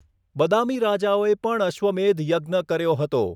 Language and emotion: Gujarati, neutral